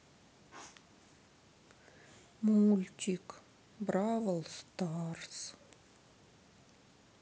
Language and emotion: Russian, sad